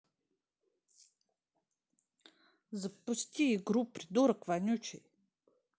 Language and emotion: Russian, angry